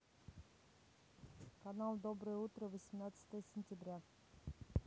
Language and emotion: Russian, neutral